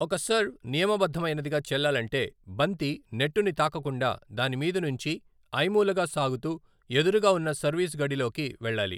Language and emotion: Telugu, neutral